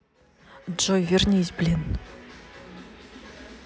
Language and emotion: Russian, angry